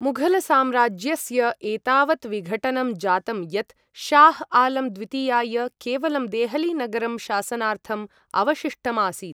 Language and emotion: Sanskrit, neutral